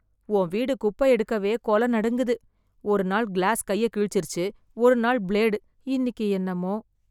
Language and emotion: Tamil, fearful